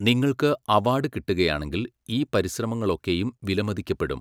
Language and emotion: Malayalam, neutral